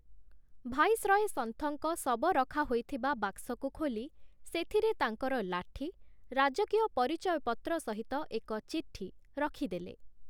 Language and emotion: Odia, neutral